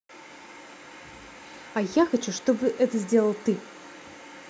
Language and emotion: Russian, angry